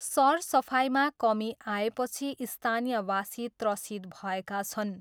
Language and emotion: Nepali, neutral